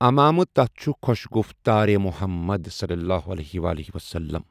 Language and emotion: Kashmiri, neutral